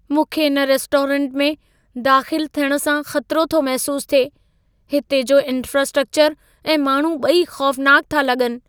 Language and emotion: Sindhi, fearful